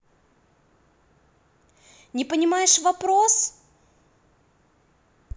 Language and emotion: Russian, angry